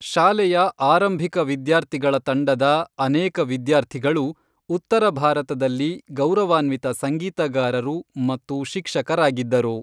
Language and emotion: Kannada, neutral